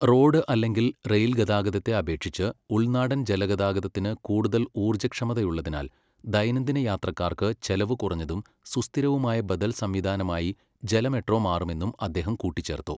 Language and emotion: Malayalam, neutral